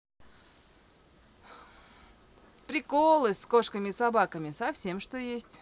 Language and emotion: Russian, positive